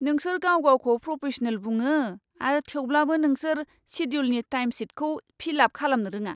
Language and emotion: Bodo, disgusted